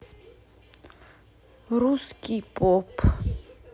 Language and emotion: Russian, sad